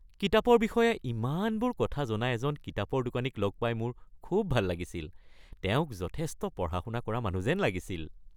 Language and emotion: Assamese, happy